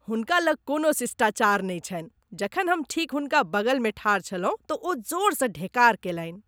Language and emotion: Maithili, disgusted